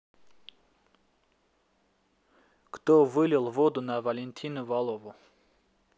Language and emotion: Russian, neutral